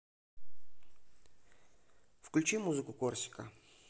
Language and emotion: Russian, neutral